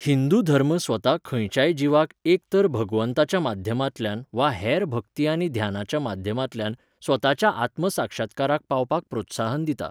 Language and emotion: Goan Konkani, neutral